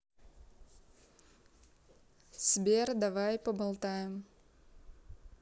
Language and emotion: Russian, neutral